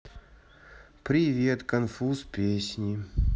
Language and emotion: Russian, sad